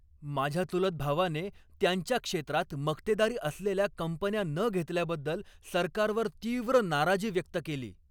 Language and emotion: Marathi, angry